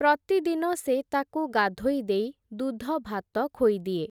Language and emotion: Odia, neutral